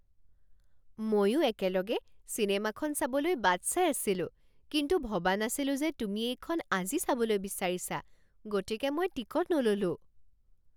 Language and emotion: Assamese, surprised